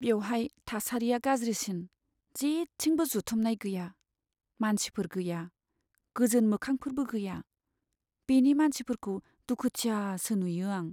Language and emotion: Bodo, sad